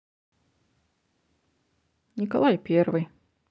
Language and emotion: Russian, neutral